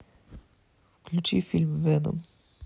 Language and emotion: Russian, sad